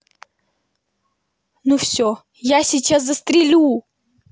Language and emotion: Russian, angry